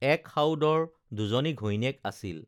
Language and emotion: Assamese, neutral